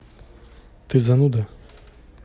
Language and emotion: Russian, neutral